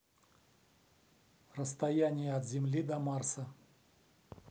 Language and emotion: Russian, neutral